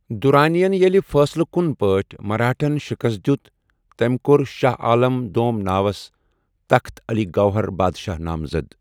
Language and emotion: Kashmiri, neutral